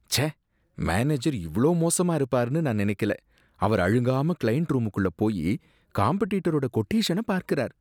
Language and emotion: Tamil, disgusted